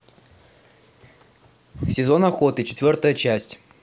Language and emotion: Russian, neutral